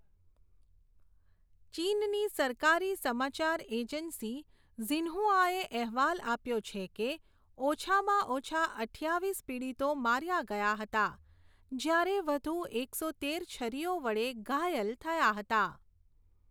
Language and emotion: Gujarati, neutral